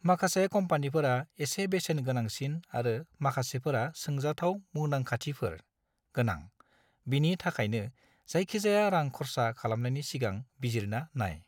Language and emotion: Bodo, neutral